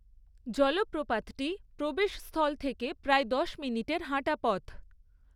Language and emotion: Bengali, neutral